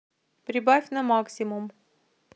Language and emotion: Russian, neutral